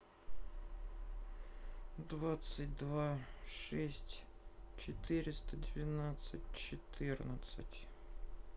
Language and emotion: Russian, sad